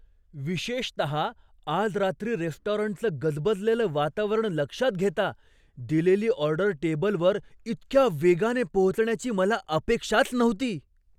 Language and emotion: Marathi, surprised